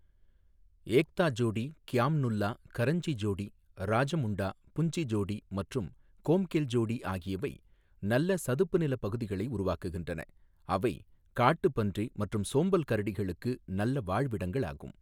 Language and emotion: Tamil, neutral